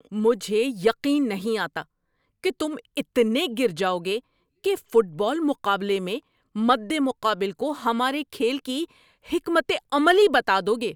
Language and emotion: Urdu, angry